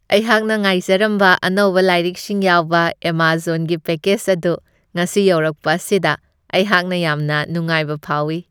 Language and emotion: Manipuri, happy